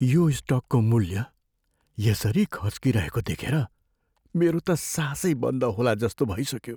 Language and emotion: Nepali, fearful